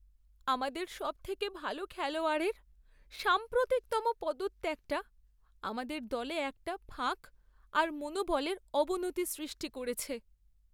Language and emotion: Bengali, sad